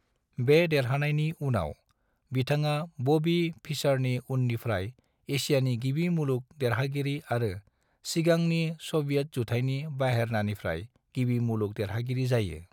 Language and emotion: Bodo, neutral